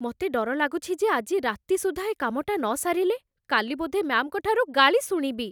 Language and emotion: Odia, fearful